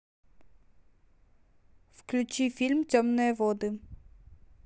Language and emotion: Russian, neutral